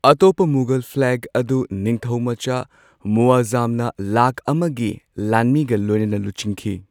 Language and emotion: Manipuri, neutral